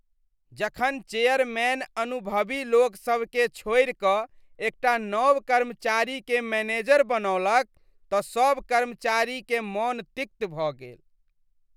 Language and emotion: Maithili, disgusted